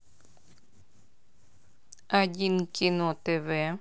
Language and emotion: Russian, neutral